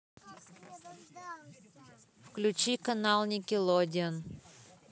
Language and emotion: Russian, neutral